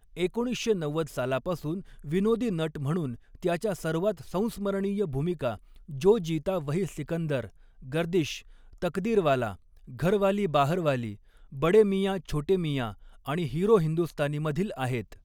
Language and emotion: Marathi, neutral